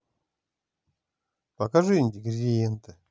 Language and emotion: Russian, positive